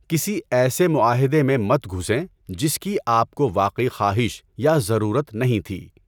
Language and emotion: Urdu, neutral